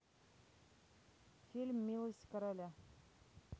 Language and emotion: Russian, neutral